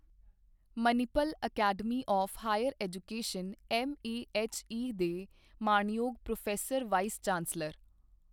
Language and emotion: Punjabi, neutral